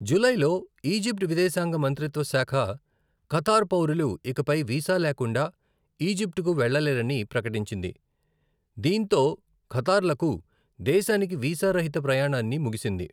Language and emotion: Telugu, neutral